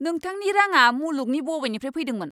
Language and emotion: Bodo, angry